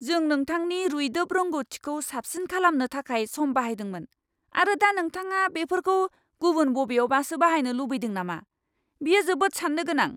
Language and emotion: Bodo, angry